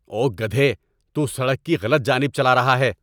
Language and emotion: Urdu, angry